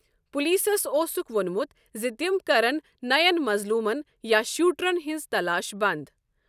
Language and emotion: Kashmiri, neutral